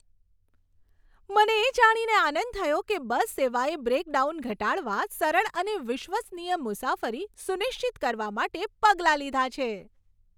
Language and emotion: Gujarati, happy